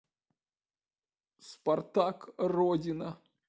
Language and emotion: Russian, sad